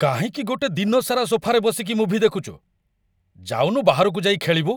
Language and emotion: Odia, angry